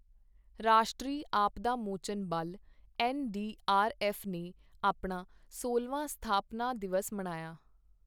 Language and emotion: Punjabi, neutral